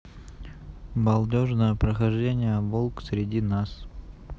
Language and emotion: Russian, neutral